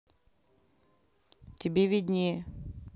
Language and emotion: Russian, neutral